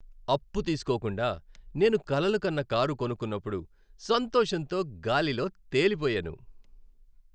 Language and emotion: Telugu, happy